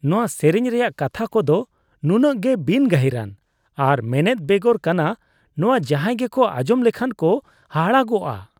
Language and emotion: Santali, disgusted